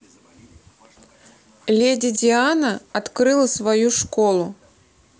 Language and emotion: Russian, neutral